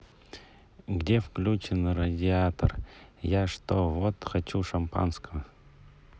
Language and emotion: Russian, neutral